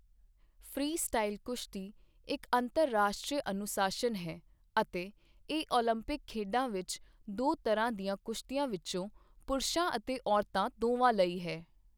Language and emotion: Punjabi, neutral